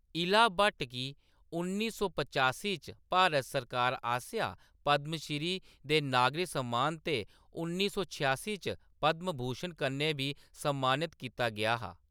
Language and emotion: Dogri, neutral